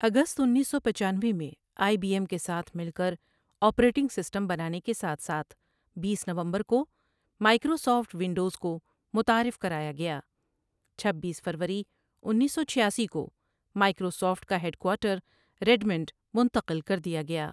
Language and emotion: Urdu, neutral